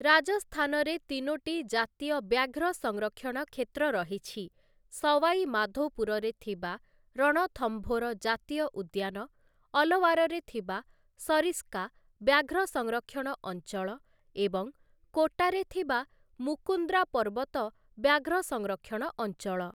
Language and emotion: Odia, neutral